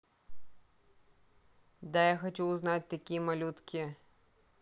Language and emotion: Russian, neutral